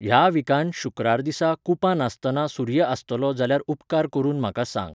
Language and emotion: Goan Konkani, neutral